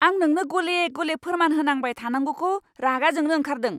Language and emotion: Bodo, angry